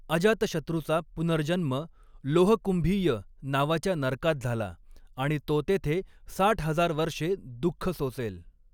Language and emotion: Marathi, neutral